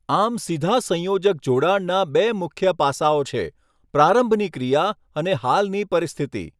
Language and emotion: Gujarati, neutral